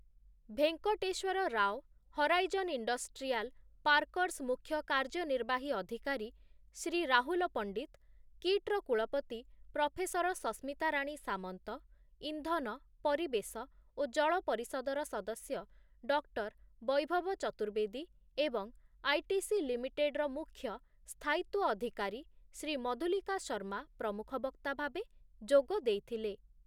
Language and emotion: Odia, neutral